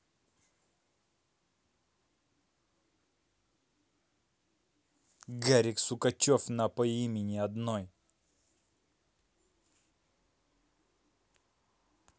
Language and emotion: Russian, neutral